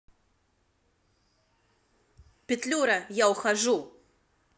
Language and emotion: Russian, angry